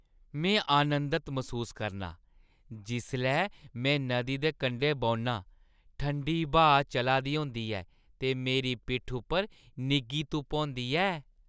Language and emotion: Dogri, happy